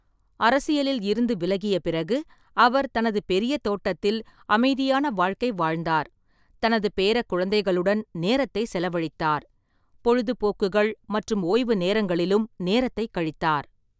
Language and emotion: Tamil, neutral